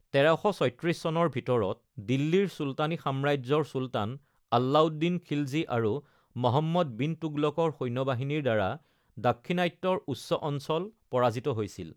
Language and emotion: Assamese, neutral